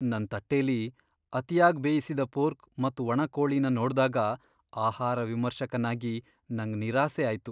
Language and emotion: Kannada, sad